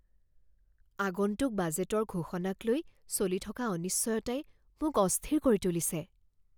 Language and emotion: Assamese, fearful